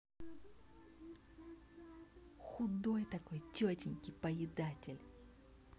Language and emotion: Russian, angry